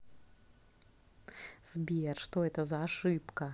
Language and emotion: Russian, positive